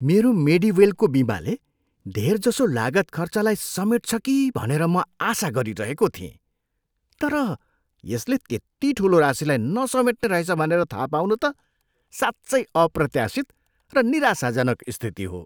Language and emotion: Nepali, surprised